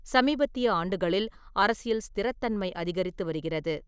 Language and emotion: Tamil, neutral